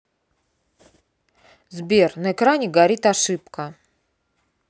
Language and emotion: Russian, angry